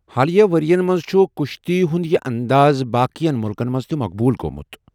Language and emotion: Kashmiri, neutral